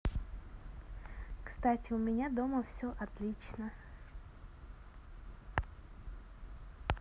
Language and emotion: Russian, positive